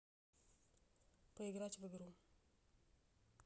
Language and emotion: Russian, neutral